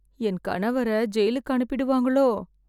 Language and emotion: Tamil, fearful